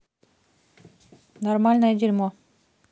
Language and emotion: Russian, neutral